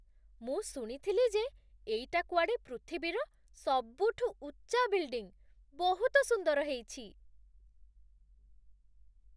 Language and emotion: Odia, surprised